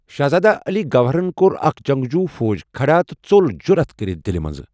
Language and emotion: Kashmiri, neutral